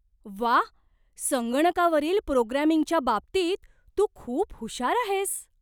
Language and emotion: Marathi, surprised